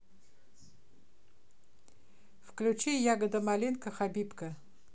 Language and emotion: Russian, neutral